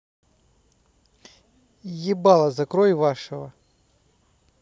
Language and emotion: Russian, angry